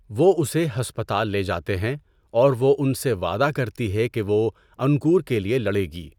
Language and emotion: Urdu, neutral